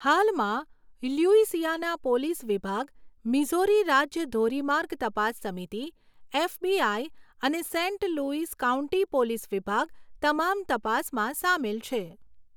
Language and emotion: Gujarati, neutral